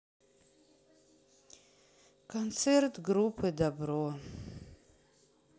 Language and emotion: Russian, sad